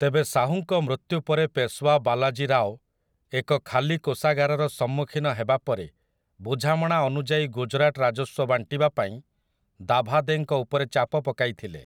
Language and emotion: Odia, neutral